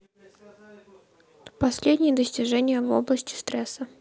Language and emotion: Russian, neutral